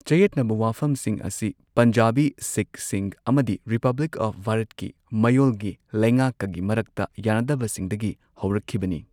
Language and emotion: Manipuri, neutral